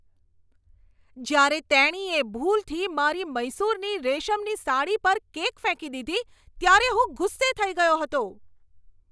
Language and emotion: Gujarati, angry